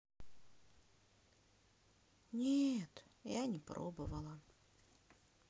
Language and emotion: Russian, sad